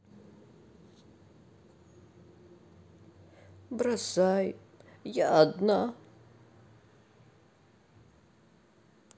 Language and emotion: Russian, sad